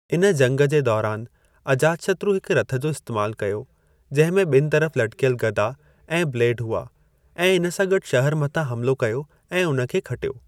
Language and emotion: Sindhi, neutral